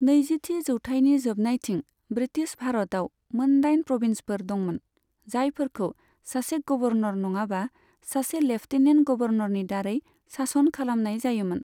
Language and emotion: Bodo, neutral